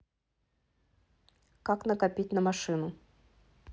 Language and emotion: Russian, neutral